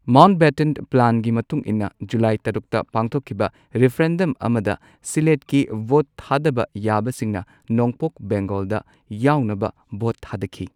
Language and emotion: Manipuri, neutral